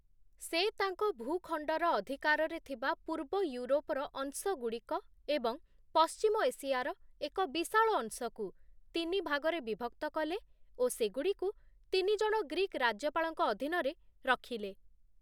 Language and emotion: Odia, neutral